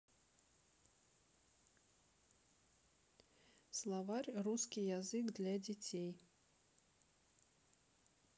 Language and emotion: Russian, neutral